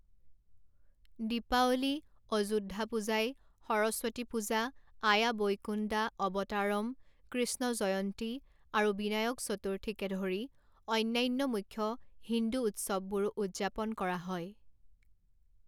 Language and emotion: Assamese, neutral